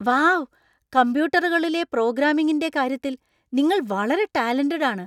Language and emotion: Malayalam, surprised